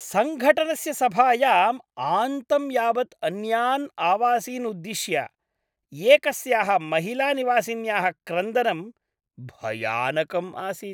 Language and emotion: Sanskrit, disgusted